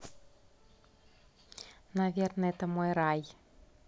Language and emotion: Russian, positive